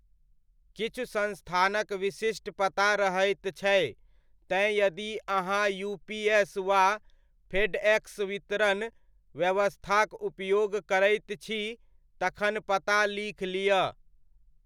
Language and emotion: Maithili, neutral